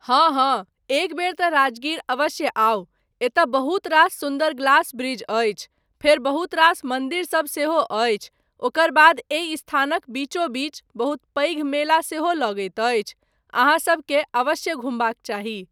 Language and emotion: Maithili, neutral